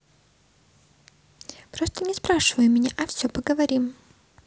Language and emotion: Russian, neutral